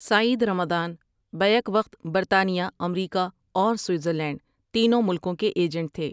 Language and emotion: Urdu, neutral